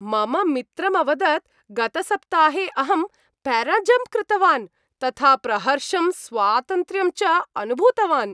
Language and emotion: Sanskrit, happy